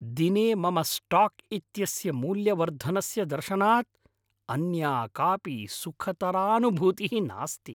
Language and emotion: Sanskrit, happy